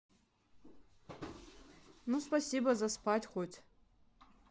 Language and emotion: Russian, neutral